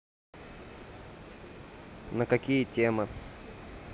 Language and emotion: Russian, neutral